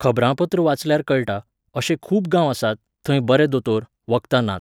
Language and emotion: Goan Konkani, neutral